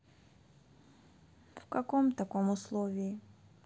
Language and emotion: Russian, sad